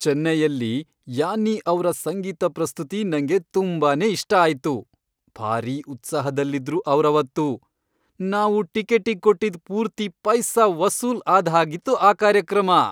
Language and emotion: Kannada, happy